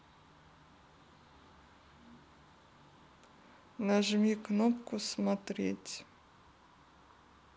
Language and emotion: Russian, neutral